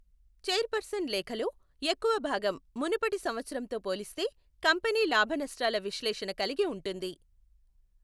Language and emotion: Telugu, neutral